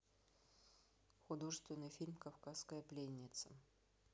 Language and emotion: Russian, neutral